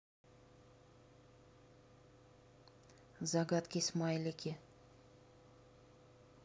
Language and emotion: Russian, neutral